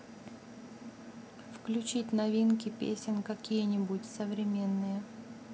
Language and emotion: Russian, neutral